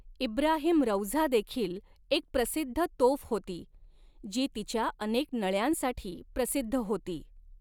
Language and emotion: Marathi, neutral